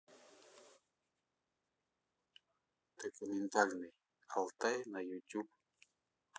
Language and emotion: Russian, neutral